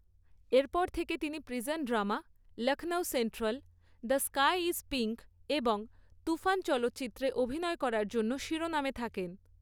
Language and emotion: Bengali, neutral